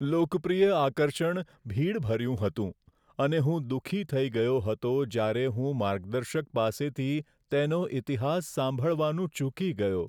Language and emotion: Gujarati, sad